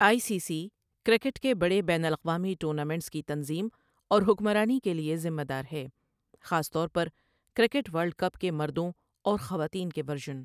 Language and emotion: Urdu, neutral